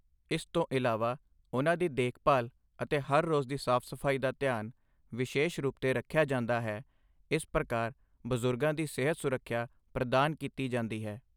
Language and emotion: Punjabi, neutral